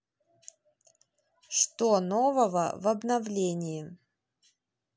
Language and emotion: Russian, neutral